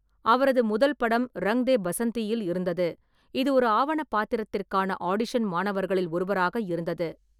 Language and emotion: Tamil, neutral